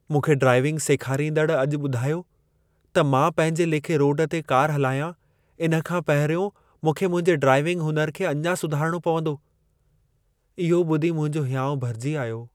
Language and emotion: Sindhi, sad